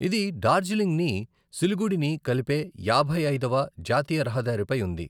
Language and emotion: Telugu, neutral